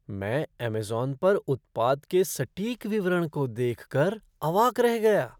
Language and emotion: Hindi, surprised